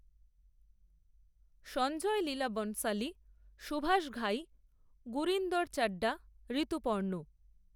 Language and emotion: Bengali, neutral